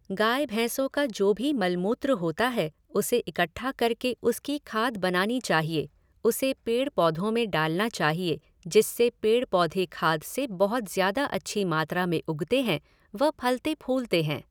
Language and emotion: Hindi, neutral